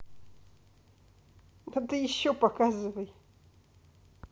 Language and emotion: Russian, neutral